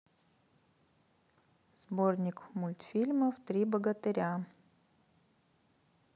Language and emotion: Russian, neutral